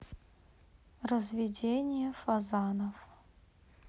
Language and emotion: Russian, neutral